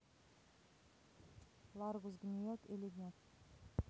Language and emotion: Russian, neutral